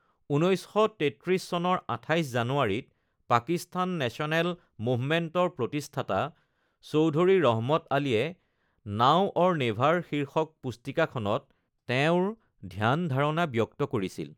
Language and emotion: Assamese, neutral